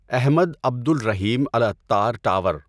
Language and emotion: Urdu, neutral